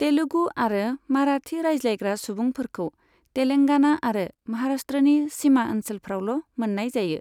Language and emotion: Bodo, neutral